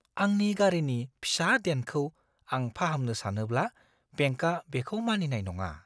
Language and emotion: Bodo, fearful